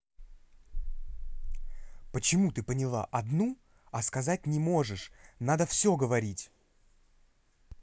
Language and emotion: Russian, angry